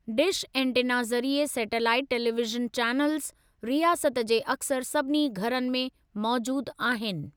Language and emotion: Sindhi, neutral